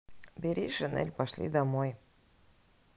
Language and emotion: Russian, neutral